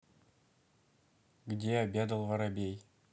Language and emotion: Russian, neutral